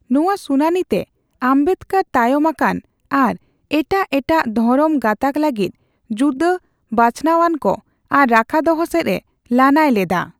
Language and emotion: Santali, neutral